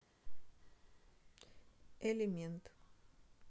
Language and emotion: Russian, neutral